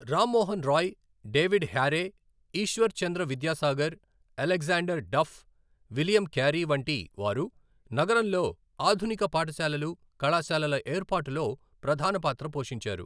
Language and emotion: Telugu, neutral